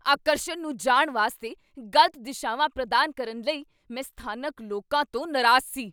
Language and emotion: Punjabi, angry